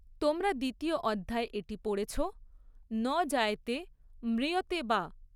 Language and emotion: Bengali, neutral